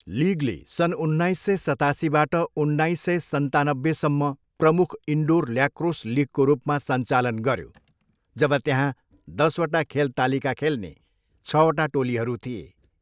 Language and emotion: Nepali, neutral